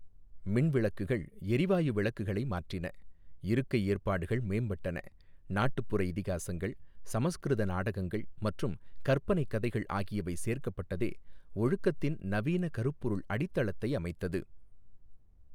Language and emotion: Tamil, neutral